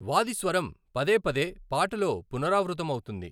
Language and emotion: Telugu, neutral